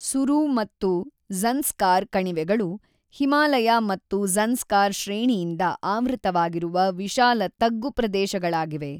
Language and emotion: Kannada, neutral